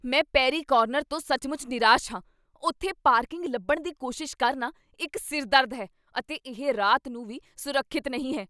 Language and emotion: Punjabi, angry